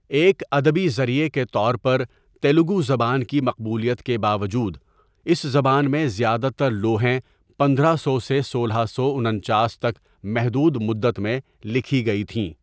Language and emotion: Urdu, neutral